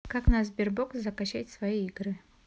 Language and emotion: Russian, neutral